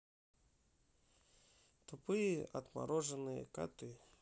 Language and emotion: Russian, neutral